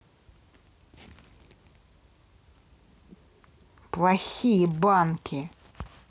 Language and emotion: Russian, angry